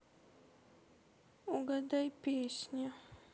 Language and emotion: Russian, sad